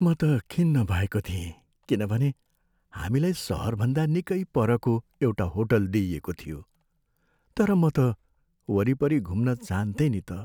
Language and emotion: Nepali, sad